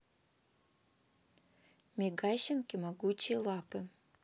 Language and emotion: Russian, neutral